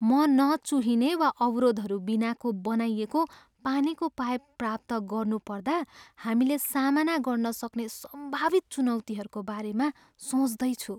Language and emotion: Nepali, fearful